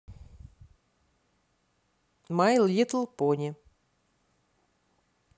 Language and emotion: Russian, positive